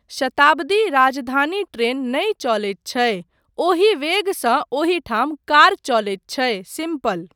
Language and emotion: Maithili, neutral